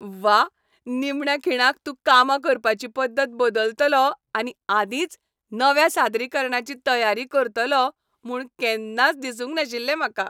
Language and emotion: Goan Konkani, happy